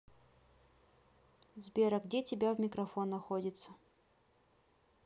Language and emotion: Russian, neutral